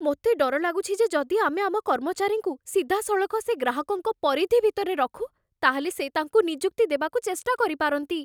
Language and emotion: Odia, fearful